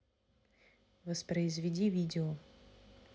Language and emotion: Russian, neutral